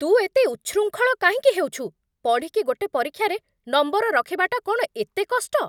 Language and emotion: Odia, angry